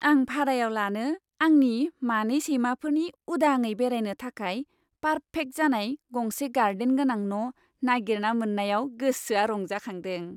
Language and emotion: Bodo, happy